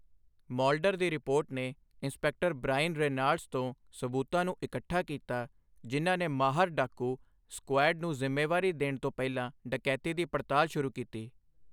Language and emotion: Punjabi, neutral